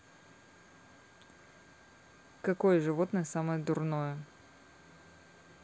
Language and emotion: Russian, neutral